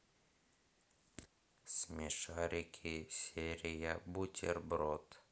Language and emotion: Russian, neutral